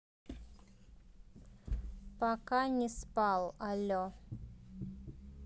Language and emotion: Russian, neutral